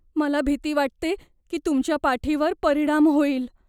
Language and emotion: Marathi, fearful